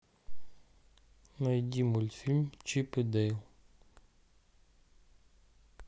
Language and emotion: Russian, neutral